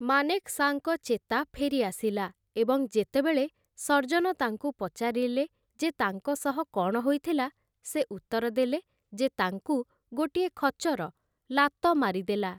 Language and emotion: Odia, neutral